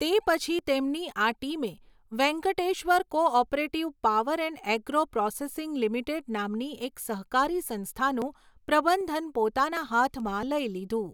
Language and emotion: Gujarati, neutral